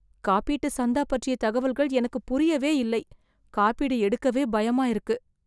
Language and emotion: Tamil, fearful